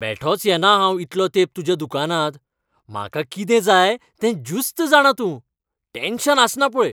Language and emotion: Goan Konkani, happy